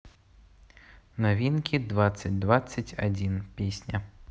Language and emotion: Russian, neutral